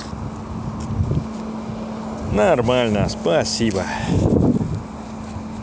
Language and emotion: Russian, positive